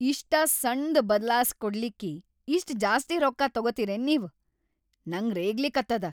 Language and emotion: Kannada, angry